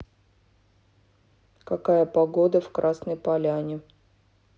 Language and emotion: Russian, neutral